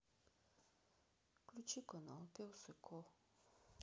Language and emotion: Russian, sad